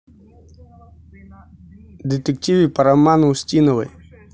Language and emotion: Russian, neutral